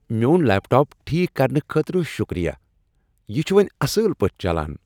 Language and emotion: Kashmiri, happy